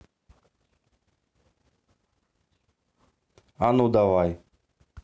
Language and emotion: Russian, neutral